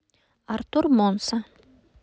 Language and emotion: Russian, neutral